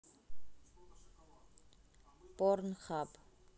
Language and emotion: Russian, neutral